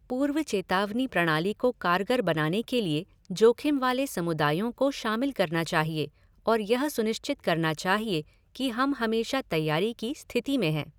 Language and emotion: Hindi, neutral